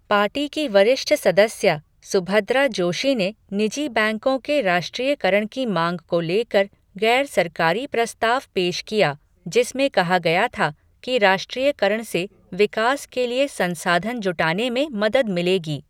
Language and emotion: Hindi, neutral